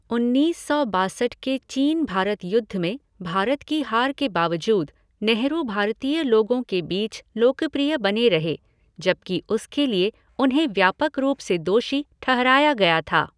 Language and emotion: Hindi, neutral